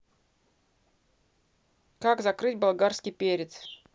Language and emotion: Russian, neutral